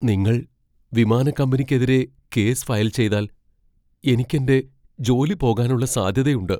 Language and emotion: Malayalam, fearful